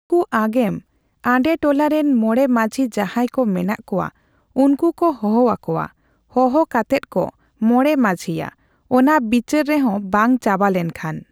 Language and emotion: Santali, neutral